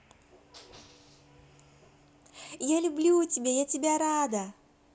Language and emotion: Russian, positive